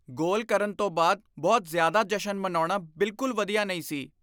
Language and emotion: Punjabi, disgusted